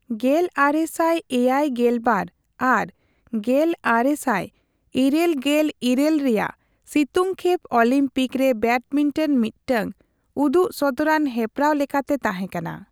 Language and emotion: Santali, neutral